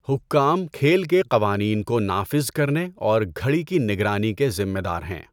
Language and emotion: Urdu, neutral